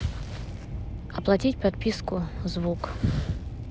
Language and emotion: Russian, neutral